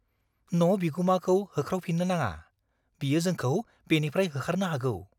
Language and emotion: Bodo, fearful